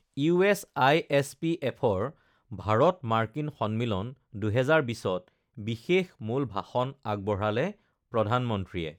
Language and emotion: Assamese, neutral